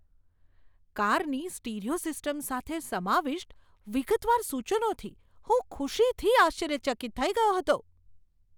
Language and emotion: Gujarati, surprised